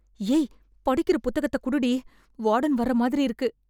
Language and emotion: Tamil, fearful